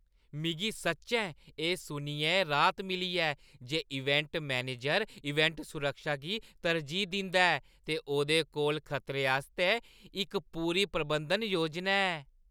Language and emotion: Dogri, happy